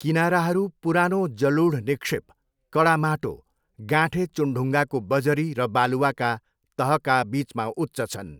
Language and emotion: Nepali, neutral